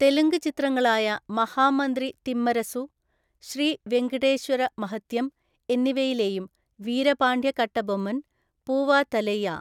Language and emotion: Malayalam, neutral